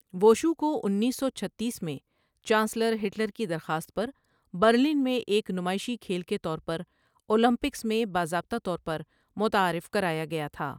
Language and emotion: Urdu, neutral